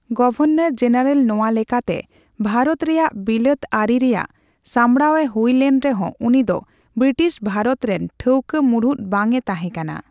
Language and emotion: Santali, neutral